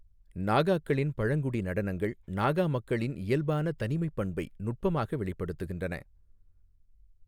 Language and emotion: Tamil, neutral